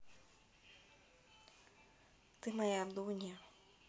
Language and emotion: Russian, neutral